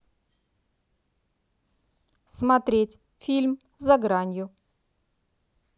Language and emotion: Russian, neutral